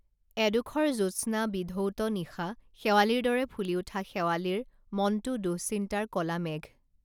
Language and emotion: Assamese, neutral